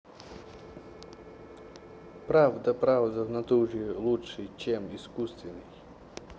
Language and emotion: Russian, neutral